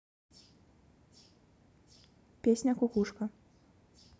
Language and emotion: Russian, neutral